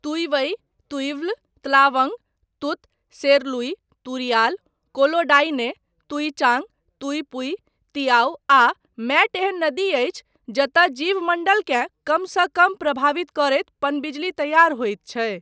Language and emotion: Maithili, neutral